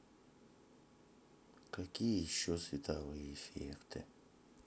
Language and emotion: Russian, sad